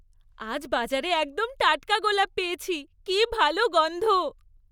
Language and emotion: Bengali, happy